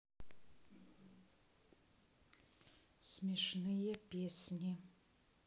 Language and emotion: Russian, neutral